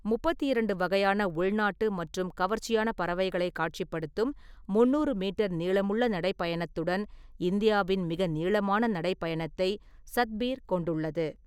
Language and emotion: Tamil, neutral